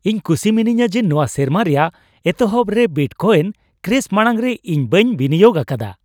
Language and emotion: Santali, happy